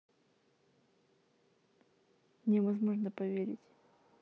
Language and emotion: Russian, neutral